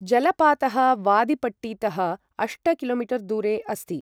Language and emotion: Sanskrit, neutral